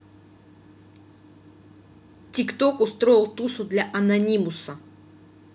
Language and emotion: Russian, angry